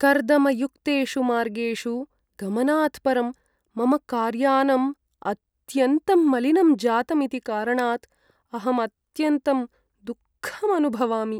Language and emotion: Sanskrit, sad